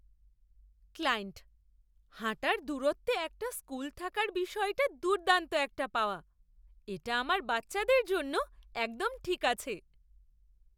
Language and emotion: Bengali, surprised